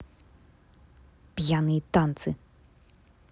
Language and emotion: Russian, angry